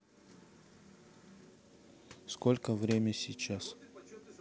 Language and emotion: Russian, neutral